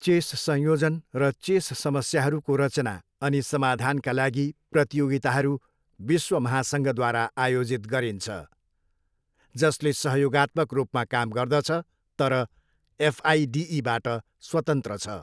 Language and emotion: Nepali, neutral